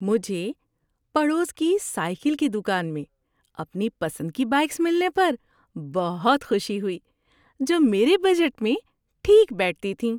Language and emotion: Urdu, happy